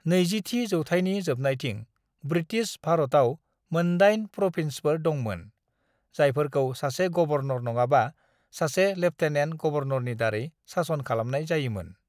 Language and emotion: Bodo, neutral